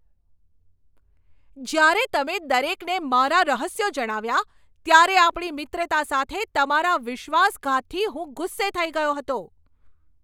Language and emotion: Gujarati, angry